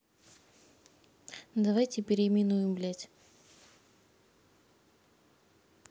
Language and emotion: Russian, neutral